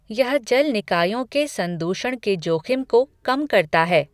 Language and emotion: Hindi, neutral